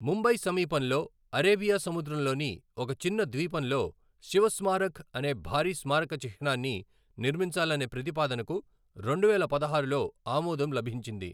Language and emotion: Telugu, neutral